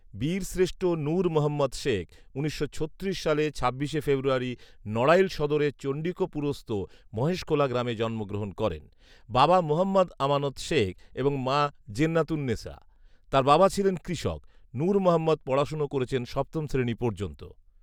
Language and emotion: Bengali, neutral